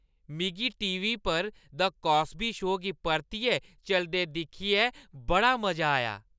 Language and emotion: Dogri, happy